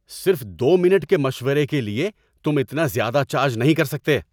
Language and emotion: Urdu, angry